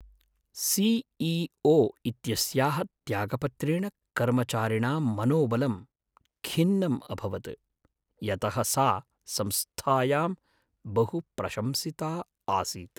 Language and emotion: Sanskrit, sad